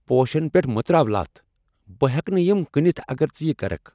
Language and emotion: Kashmiri, angry